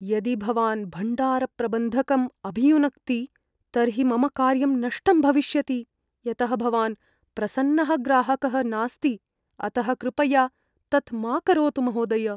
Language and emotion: Sanskrit, fearful